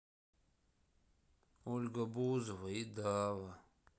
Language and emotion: Russian, sad